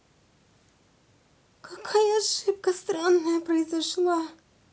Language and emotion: Russian, sad